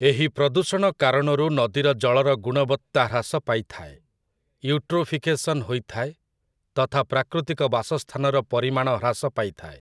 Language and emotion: Odia, neutral